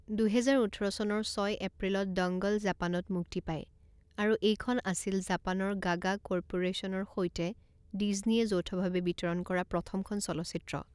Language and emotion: Assamese, neutral